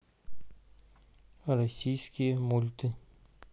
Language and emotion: Russian, neutral